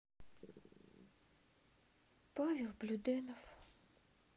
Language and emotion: Russian, sad